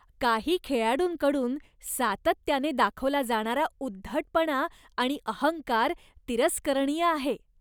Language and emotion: Marathi, disgusted